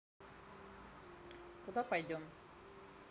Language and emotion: Russian, neutral